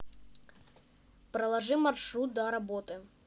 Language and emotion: Russian, neutral